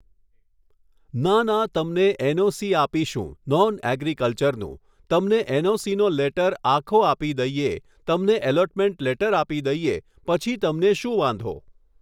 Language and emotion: Gujarati, neutral